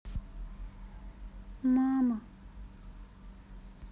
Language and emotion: Russian, sad